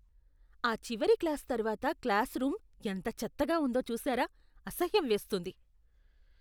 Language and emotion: Telugu, disgusted